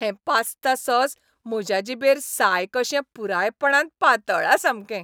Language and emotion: Goan Konkani, happy